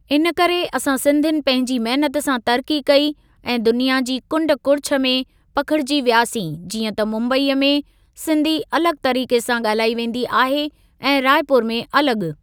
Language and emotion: Sindhi, neutral